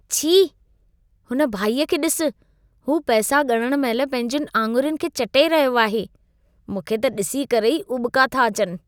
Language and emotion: Sindhi, disgusted